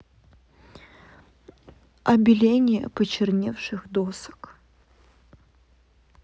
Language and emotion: Russian, neutral